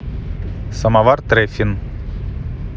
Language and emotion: Russian, neutral